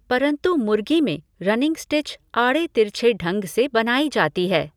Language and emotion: Hindi, neutral